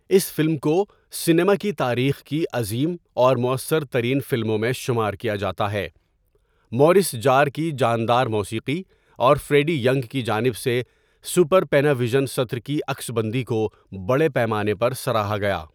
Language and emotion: Urdu, neutral